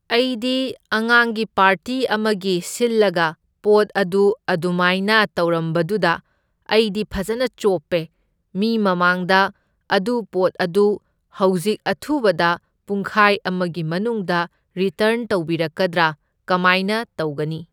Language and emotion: Manipuri, neutral